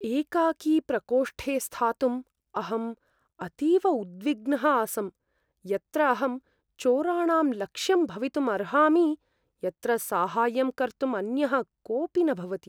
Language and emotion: Sanskrit, fearful